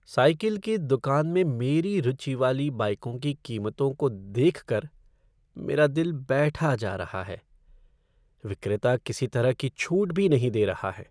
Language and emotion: Hindi, sad